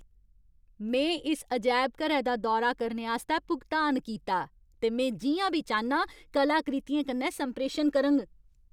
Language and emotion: Dogri, angry